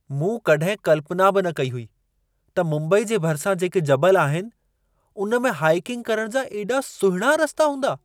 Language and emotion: Sindhi, surprised